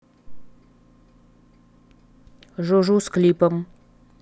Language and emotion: Russian, neutral